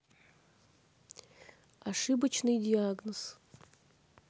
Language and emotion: Russian, neutral